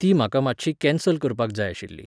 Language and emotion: Goan Konkani, neutral